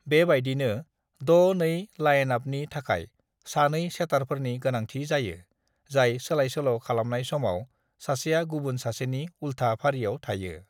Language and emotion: Bodo, neutral